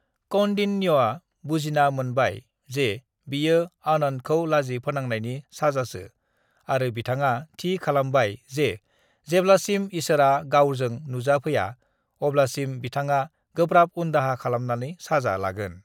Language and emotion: Bodo, neutral